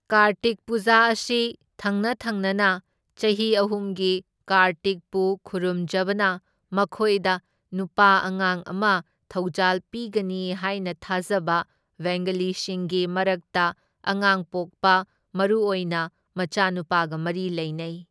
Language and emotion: Manipuri, neutral